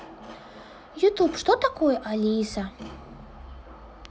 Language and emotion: Russian, neutral